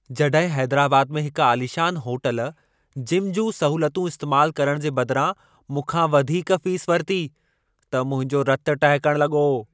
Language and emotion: Sindhi, angry